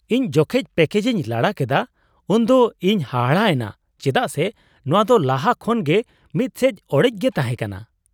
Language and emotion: Santali, surprised